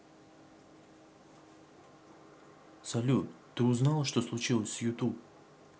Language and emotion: Russian, neutral